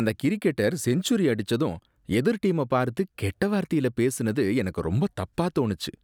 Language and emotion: Tamil, disgusted